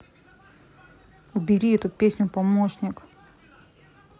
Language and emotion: Russian, angry